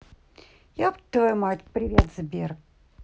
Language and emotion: Russian, neutral